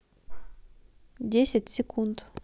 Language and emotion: Russian, neutral